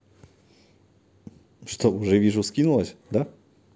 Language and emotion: Russian, positive